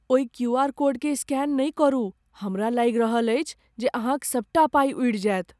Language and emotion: Maithili, fearful